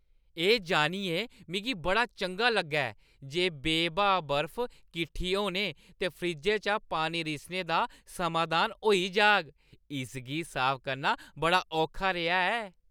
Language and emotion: Dogri, happy